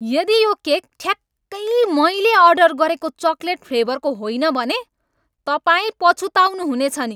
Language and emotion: Nepali, angry